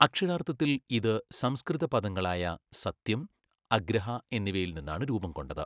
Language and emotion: Malayalam, neutral